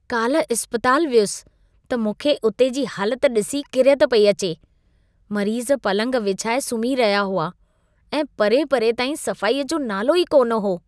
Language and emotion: Sindhi, disgusted